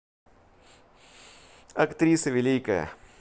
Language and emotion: Russian, positive